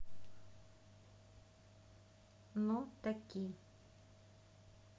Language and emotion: Russian, neutral